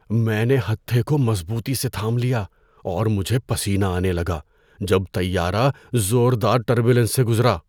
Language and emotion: Urdu, fearful